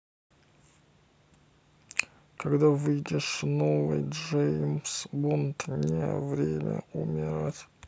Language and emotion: Russian, neutral